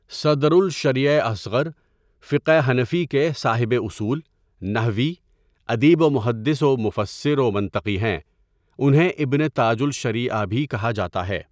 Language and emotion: Urdu, neutral